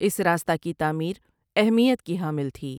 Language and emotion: Urdu, neutral